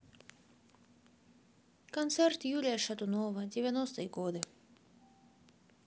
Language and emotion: Russian, neutral